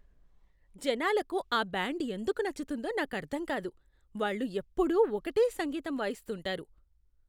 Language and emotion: Telugu, disgusted